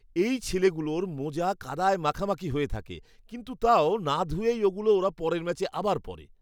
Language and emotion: Bengali, disgusted